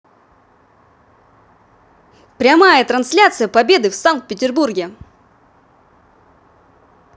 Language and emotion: Russian, positive